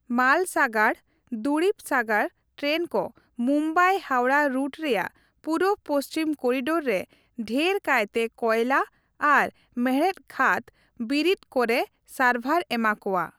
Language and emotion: Santali, neutral